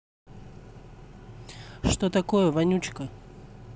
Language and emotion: Russian, angry